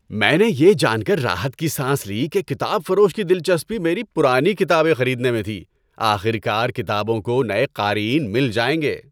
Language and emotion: Urdu, happy